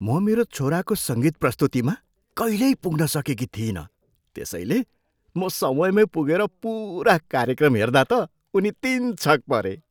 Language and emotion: Nepali, surprised